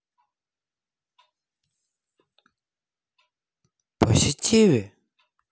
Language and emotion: Russian, neutral